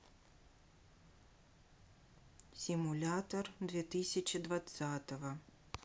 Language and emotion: Russian, neutral